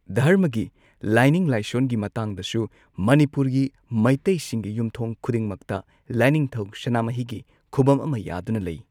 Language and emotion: Manipuri, neutral